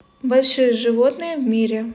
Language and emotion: Russian, neutral